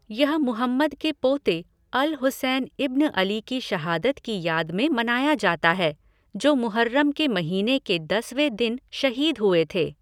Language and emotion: Hindi, neutral